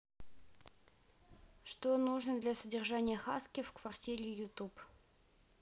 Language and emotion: Russian, neutral